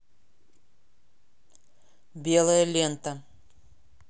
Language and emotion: Russian, neutral